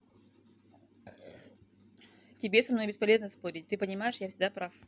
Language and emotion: Russian, neutral